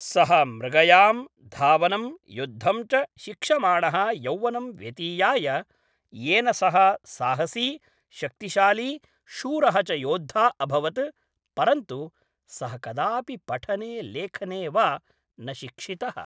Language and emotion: Sanskrit, neutral